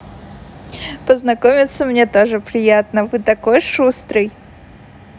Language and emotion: Russian, positive